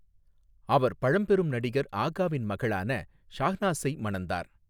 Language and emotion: Tamil, neutral